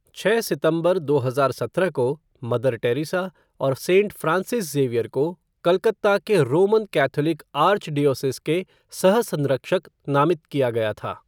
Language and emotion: Hindi, neutral